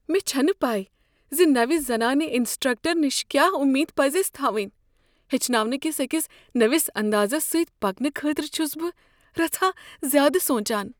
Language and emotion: Kashmiri, fearful